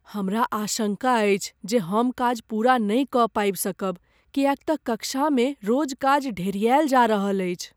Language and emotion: Maithili, fearful